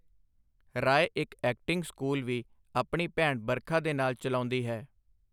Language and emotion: Punjabi, neutral